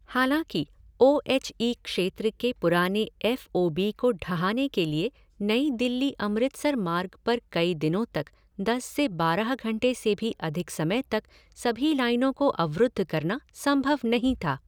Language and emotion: Hindi, neutral